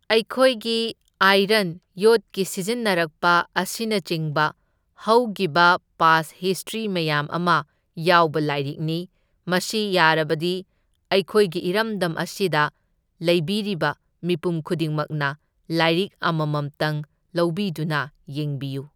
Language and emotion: Manipuri, neutral